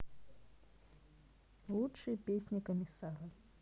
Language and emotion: Russian, neutral